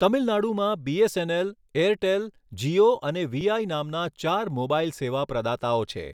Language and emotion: Gujarati, neutral